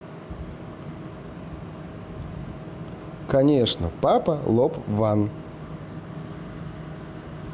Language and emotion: Russian, neutral